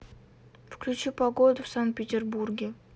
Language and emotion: Russian, neutral